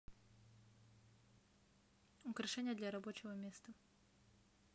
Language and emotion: Russian, neutral